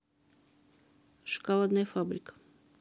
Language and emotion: Russian, neutral